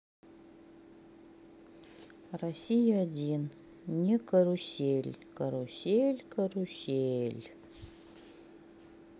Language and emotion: Russian, sad